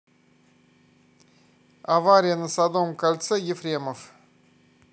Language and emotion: Russian, neutral